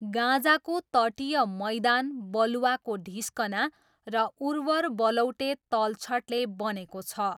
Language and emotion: Nepali, neutral